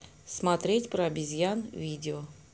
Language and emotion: Russian, neutral